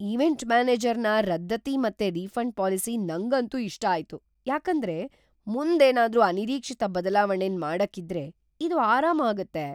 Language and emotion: Kannada, surprised